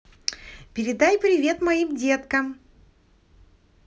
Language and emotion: Russian, positive